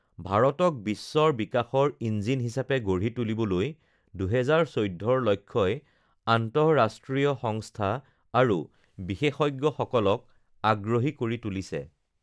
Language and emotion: Assamese, neutral